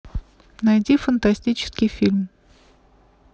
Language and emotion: Russian, neutral